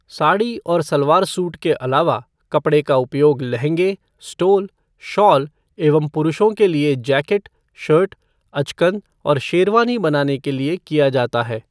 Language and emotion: Hindi, neutral